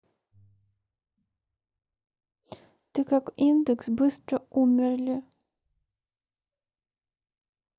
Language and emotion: Russian, sad